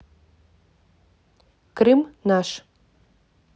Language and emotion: Russian, neutral